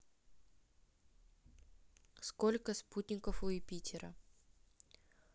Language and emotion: Russian, neutral